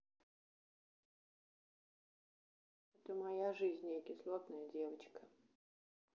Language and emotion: Russian, sad